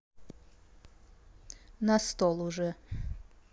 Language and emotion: Russian, neutral